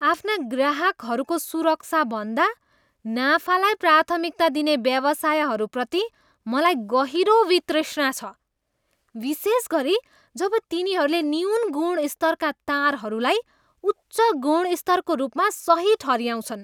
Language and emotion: Nepali, disgusted